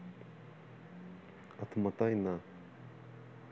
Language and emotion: Russian, neutral